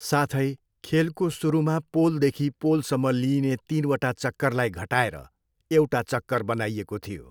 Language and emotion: Nepali, neutral